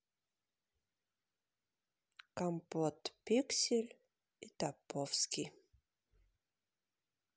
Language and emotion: Russian, sad